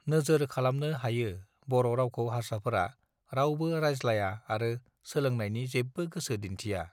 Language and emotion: Bodo, neutral